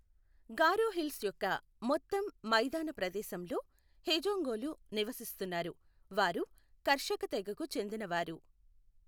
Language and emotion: Telugu, neutral